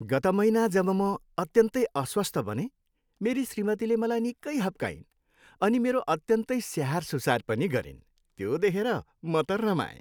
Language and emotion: Nepali, happy